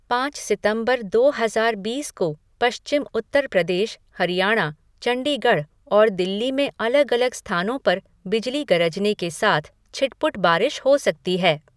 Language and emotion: Hindi, neutral